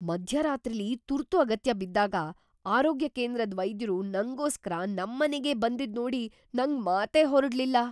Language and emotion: Kannada, surprised